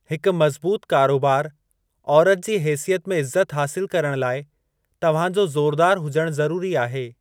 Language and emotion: Sindhi, neutral